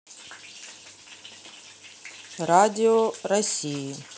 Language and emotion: Russian, neutral